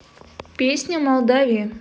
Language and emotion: Russian, neutral